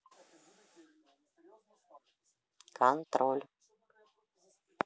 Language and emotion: Russian, neutral